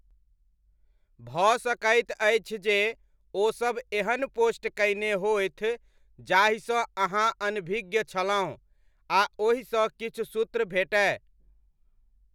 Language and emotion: Maithili, neutral